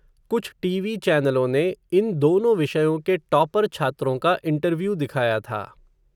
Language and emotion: Hindi, neutral